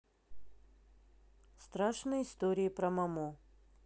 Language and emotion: Russian, neutral